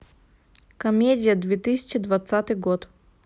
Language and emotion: Russian, neutral